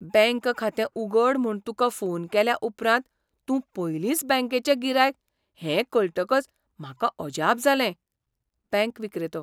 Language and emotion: Goan Konkani, surprised